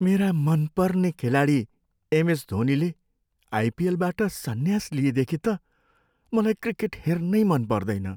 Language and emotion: Nepali, sad